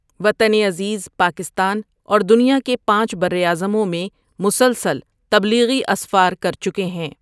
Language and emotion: Urdu, neutral